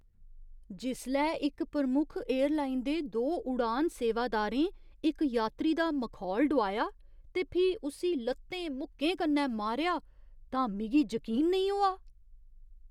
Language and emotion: Dogri, disgusted